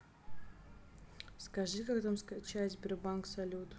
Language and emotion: Russian, neutral